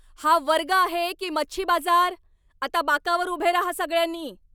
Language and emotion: Marathi, angry